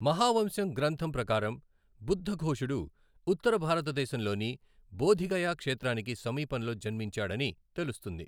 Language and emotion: Telugu, neutral